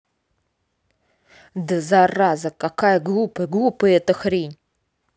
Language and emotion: Russian, angry